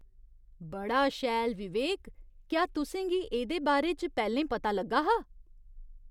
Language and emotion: Dogri, surprised